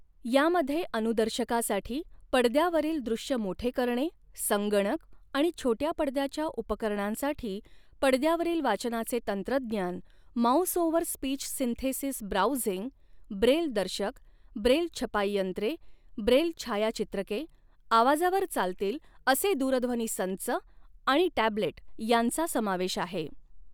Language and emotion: Marathi, neutral